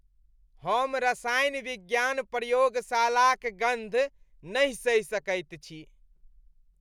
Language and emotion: Maithili, disgusted